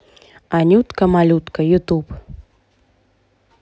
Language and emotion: Russian, neutral